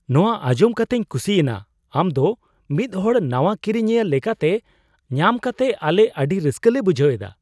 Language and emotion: Santali, surprised